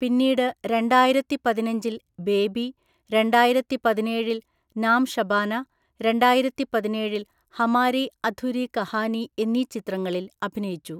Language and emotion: Malayalam, neutral